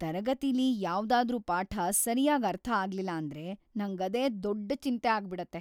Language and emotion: Kannada, fearful